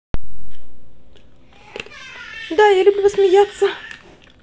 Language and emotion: Russian, positive